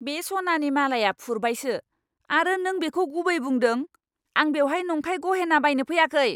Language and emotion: Bodo, angry